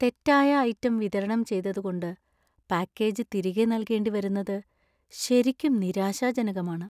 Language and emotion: Malayalam, sad